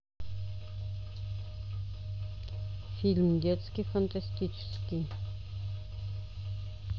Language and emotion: Russian, neutral